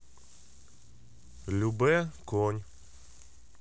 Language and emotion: Russian, neutral